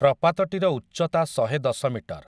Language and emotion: Odia, neutral